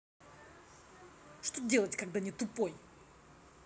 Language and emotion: Russian, angry